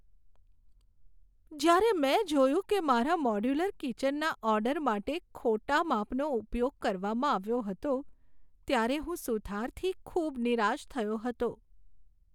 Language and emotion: Gujarati, sad